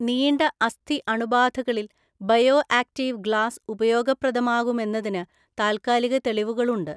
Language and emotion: Malayalam, neutral